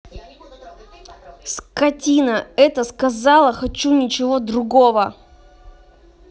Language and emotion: Russian, angry